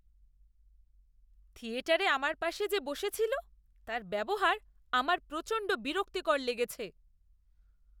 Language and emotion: Bengali, disgusted